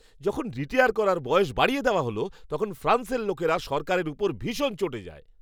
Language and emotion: Bengali, angry